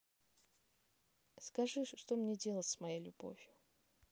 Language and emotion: Russian, neutral